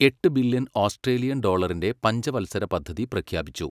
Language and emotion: Malayalam, neutral